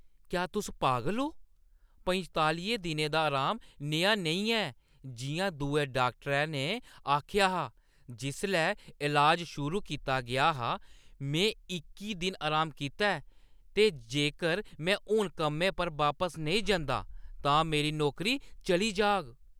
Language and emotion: Dogri, angry